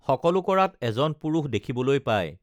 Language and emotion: Assamese, neutral